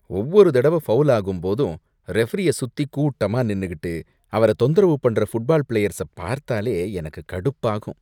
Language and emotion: Tamil, disgusted